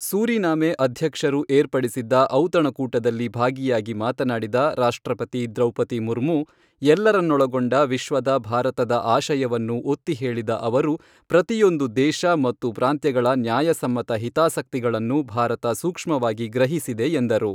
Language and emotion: Kannada, neutral